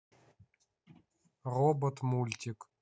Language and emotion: Russian, neutral